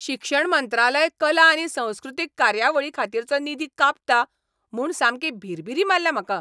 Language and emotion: Goan Konkani, angry